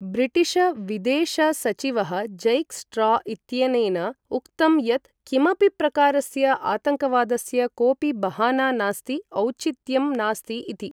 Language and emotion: Sanskrit, neutral